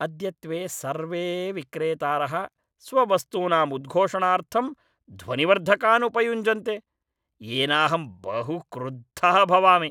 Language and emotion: Sanskrit, angry